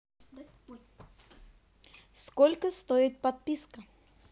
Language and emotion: Russian, neutral